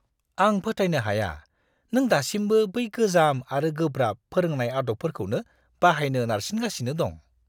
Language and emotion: Bodo, disgusted